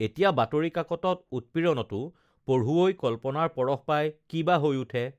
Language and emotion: Assamese, neutral